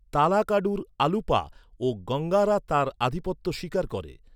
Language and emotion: Bengali, neutral